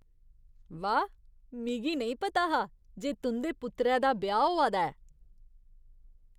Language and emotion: Dogri, surprised